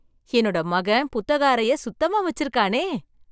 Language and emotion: Tamil, surprised